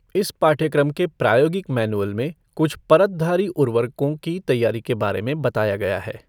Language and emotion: Hindi, neutral